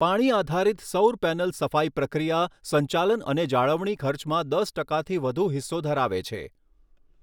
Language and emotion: Gujarati, neutral